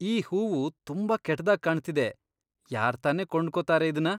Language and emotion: Kannada, disgusted